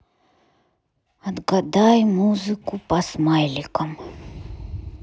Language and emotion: Russian, sad